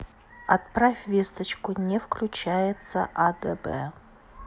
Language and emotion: Russian, neutral